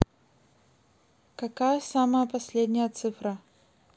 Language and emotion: Russian, neutral